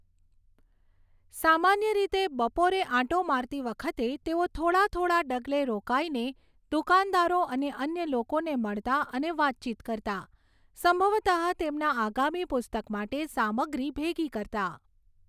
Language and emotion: Gujarati, neutral